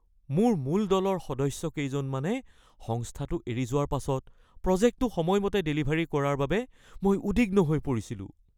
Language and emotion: Assamese, fearful